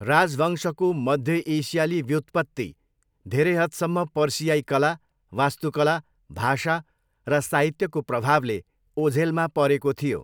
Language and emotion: Nepali, neutral